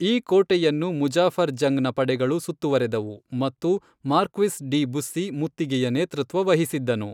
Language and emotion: Kannada, neutral